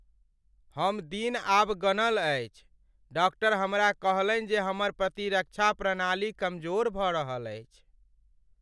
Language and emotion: Maithili, sad